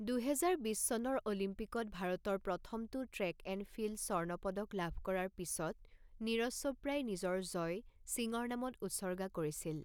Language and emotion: Assamese, neutral